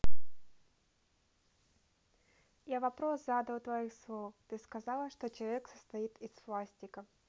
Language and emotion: Russian, neutral